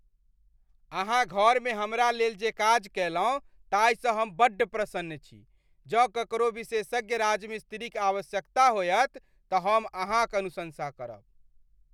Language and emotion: Maithili, happy